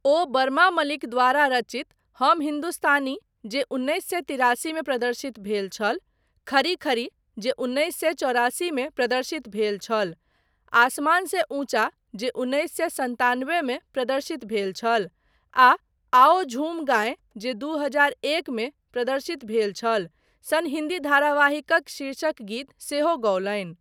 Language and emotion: Maithili, neutral